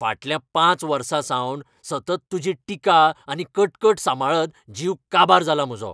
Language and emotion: Goan Konkani, angry